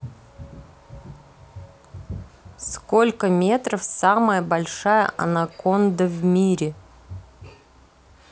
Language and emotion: Russian, neutral